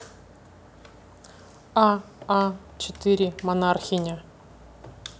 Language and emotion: Russian, neutral